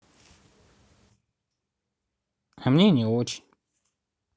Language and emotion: Russian, sad